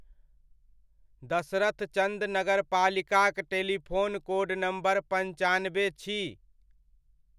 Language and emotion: Maithili, neutral